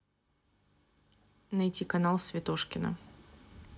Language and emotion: Russian, neutral